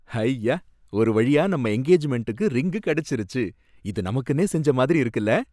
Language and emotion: Tamil, happy